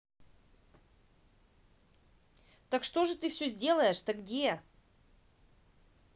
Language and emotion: Russian, angry